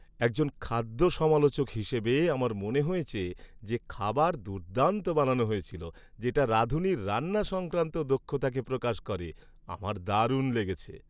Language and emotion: Bengali, happy